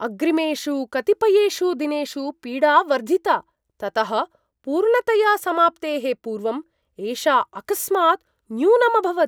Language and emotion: Sanskrit, surprised